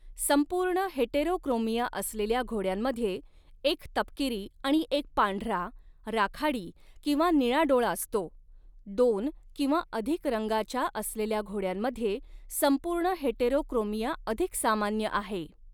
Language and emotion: Marathi, neutral